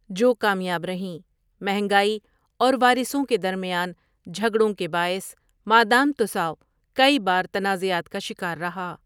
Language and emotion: Urdu, neutral